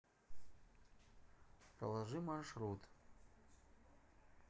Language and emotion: Russian, neutral